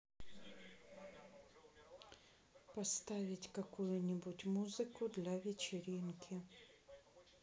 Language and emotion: Russian, sad